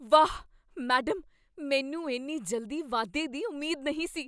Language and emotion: Punjabi, surprised